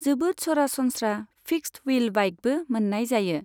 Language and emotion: Bodo, neutral